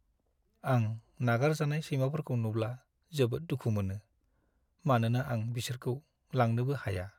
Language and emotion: Bodo, sad